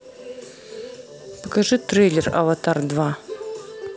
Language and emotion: Russian, neutral